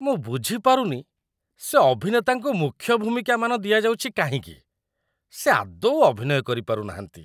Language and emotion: Odia, disgusted